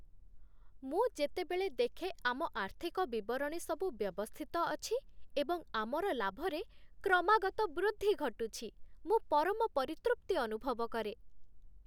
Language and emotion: Odia, happy